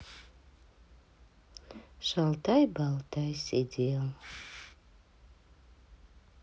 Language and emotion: Russian, sad